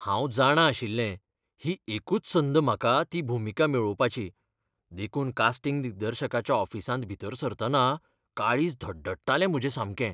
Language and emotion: Goan Konkani, fearful